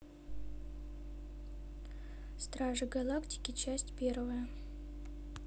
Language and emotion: Russian, neutral